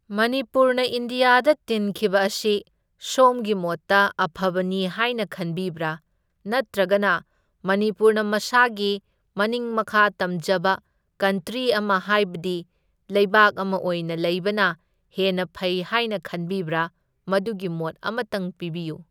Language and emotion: Manipuri, neutral